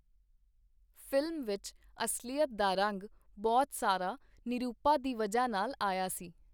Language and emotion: Punjabi, neutral